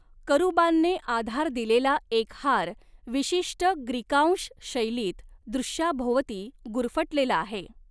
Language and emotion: Marathi, neutral